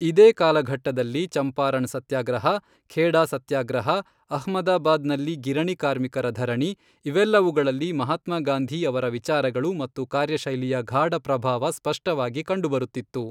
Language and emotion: Kannada, neutral